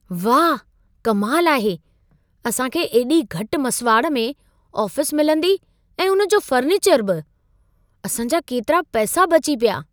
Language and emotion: Sindhi, surprised